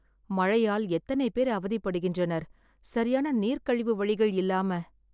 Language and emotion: Tamil, sad